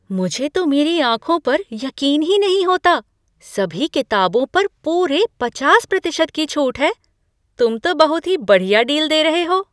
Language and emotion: Hindi, surprised